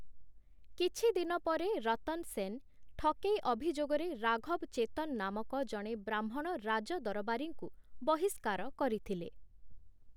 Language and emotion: Odia, neutral